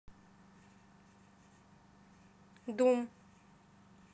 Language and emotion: Russian, neutral